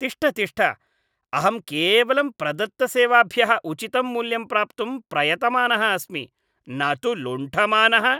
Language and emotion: Sanskrit, disgusted